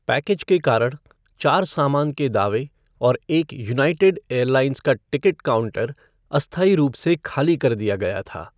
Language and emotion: Hindi, neutral